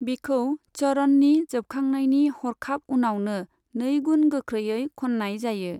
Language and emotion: Bodo, neutral